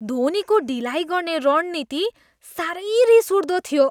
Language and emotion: Nepali, disgusted